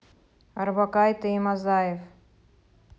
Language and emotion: Russian, neutral